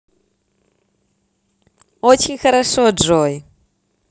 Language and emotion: Russian, positive